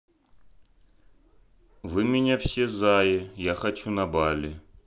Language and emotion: Russian, neutral